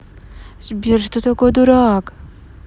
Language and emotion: Russian, neutral